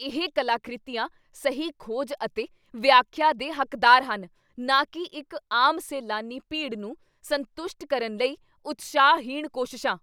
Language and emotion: Punjabi, angry